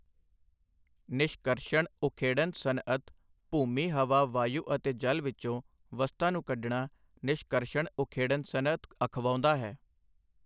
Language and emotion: Punjabi, neutral